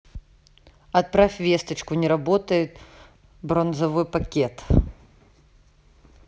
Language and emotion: Russian, neutral